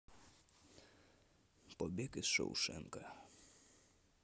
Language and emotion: Russian, neutral